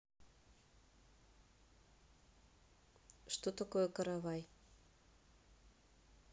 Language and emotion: Russian, neutral